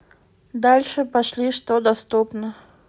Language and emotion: Russian, neutral